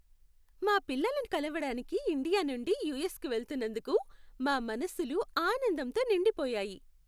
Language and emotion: Telugu, happy